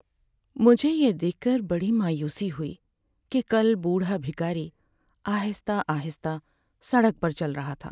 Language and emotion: Urdu, sad